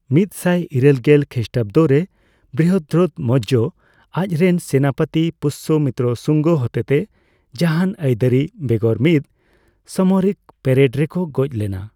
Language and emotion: Santali, neutral